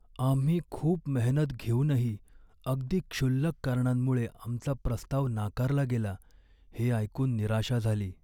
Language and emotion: Marathi, sad